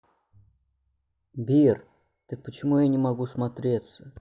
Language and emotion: Russian, neutral